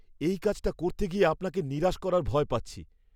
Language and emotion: Bengali, fearful